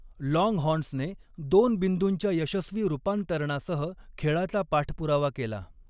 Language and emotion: Marathi, neutral